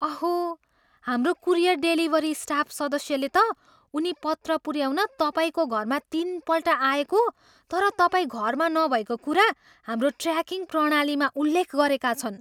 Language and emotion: Nepali, surprised